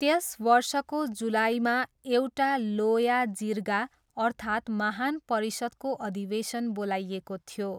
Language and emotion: Nepali, neutral